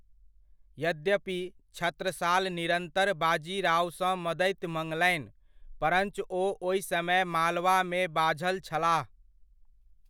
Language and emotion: Maithili, neutral